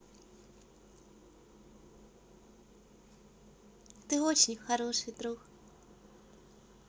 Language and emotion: Russian, positive